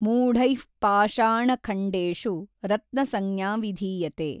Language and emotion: Kannada, neutral